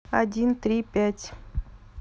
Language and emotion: Russian, neutral